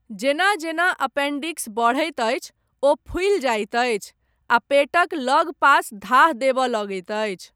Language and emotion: Maithili, neutral